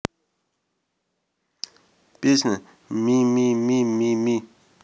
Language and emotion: Russian, neutral